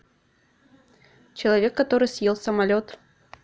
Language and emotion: Russian, neutral